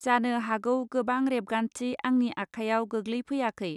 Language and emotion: Bodo, neutral